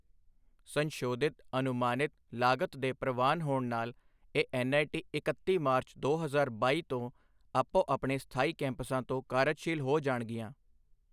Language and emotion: Punjabi, neutral